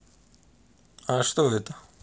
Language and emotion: Russian, neutral